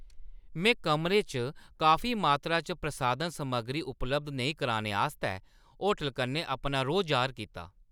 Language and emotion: Dogri, angry